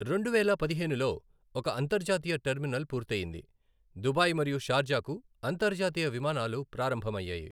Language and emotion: Telugu, neutral